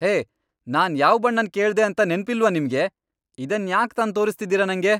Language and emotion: Kannada, angry